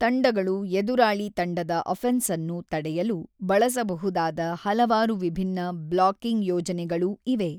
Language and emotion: Kannada, neutral